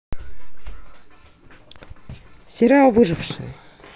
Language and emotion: Russian, neutral